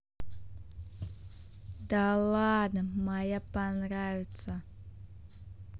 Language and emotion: Russian, positive